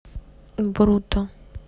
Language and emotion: Russian, neutral